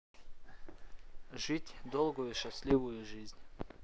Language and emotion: Russian, neutral